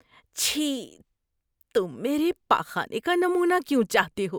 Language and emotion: Urdu, disgusted